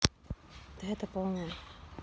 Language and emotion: Russian, neutral